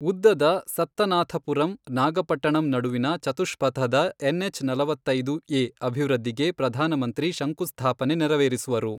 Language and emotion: Kannada, neutral